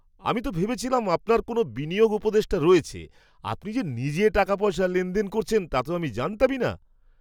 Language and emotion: Bengali, surprised